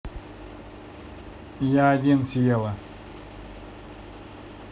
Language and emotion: Russian, neutral